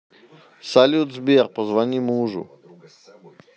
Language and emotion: Russian, neutral